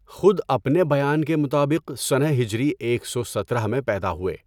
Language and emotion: Urdu, neutral